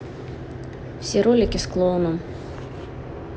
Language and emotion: Russian, neutral